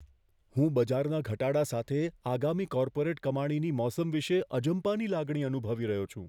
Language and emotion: Gujarati, fearful